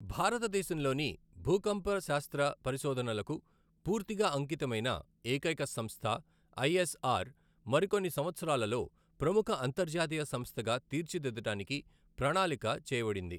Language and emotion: Telugu, neutral